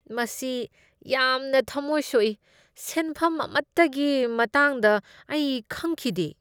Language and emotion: Manipuri, disgusted